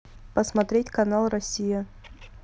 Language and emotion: Russian, neutral